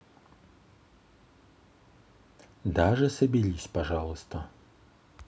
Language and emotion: Russian, neutral